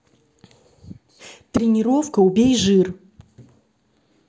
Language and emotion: Russian, neutral